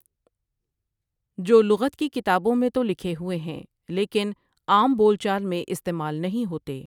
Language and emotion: Urdu, neutral